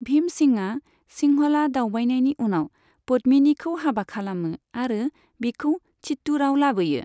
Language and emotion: Bodo, neutral